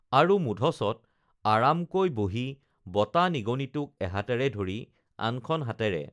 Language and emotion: Assamese, neutral